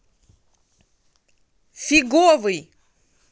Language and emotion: Russian, angry